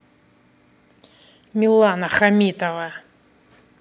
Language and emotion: Russian, angry